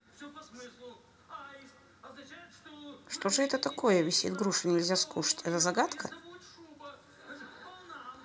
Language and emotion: Russian, neutral